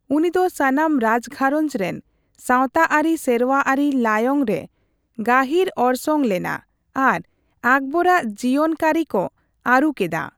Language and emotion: Santali, neutral